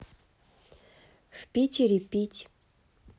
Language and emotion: Russian, neutral